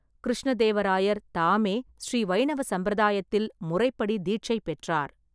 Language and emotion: Tamil, neutral